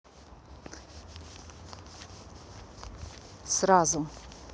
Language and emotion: Russian, neutral